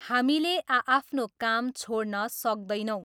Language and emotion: Nepali, neutral